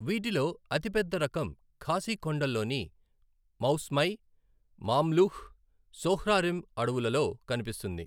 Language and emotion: Telugu, neutral